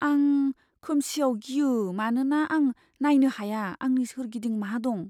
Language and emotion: Bodo, fearful